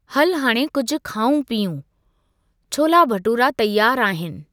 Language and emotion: Sindhi, neutral